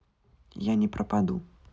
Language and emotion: Russian, neutral